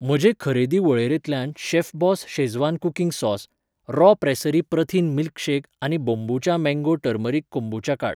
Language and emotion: Goan Konkani, neutral